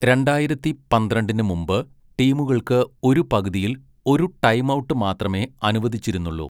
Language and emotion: Malayalam, neutral